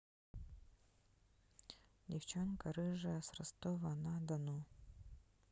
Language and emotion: Russian, neutral